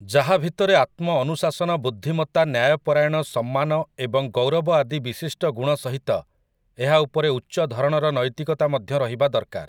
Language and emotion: Odia, neutral